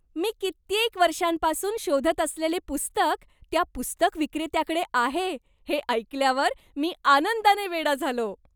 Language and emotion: Marathi, happy